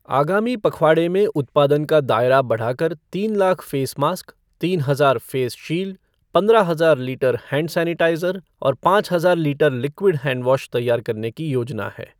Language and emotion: Hindi, neutral